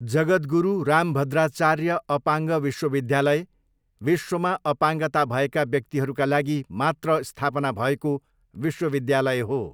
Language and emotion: Nepali, neutral